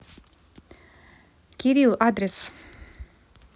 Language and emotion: Russian, neutral